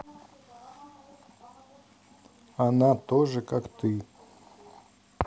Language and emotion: Russian, neutral